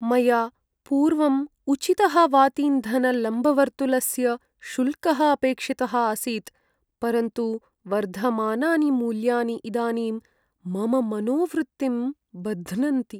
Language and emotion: Sanskrit, sad